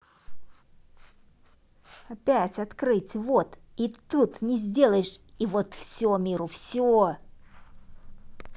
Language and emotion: Russian, angry